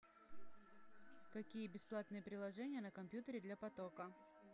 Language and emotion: Russian, neutral